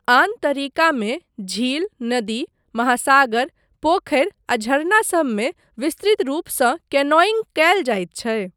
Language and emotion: Maithili, neutral